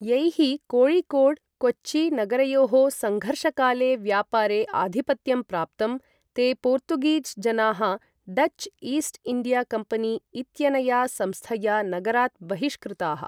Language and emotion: Sanskrit, neutral